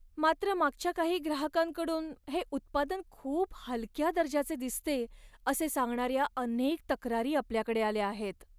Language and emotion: Marathi, sad